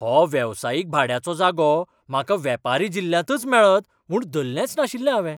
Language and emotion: Goan Konkani, surprised